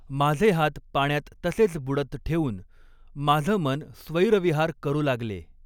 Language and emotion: Marathi, neutral